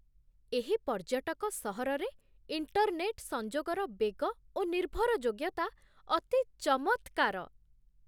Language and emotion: Odia, surprised